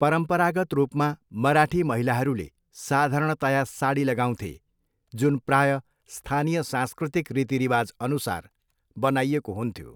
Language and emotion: Nepali, neutral